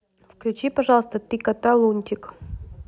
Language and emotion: Russian, neutral